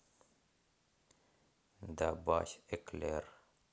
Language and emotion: Russian, neutral